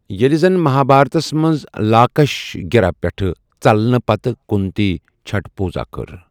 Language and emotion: Kashmiri, neutral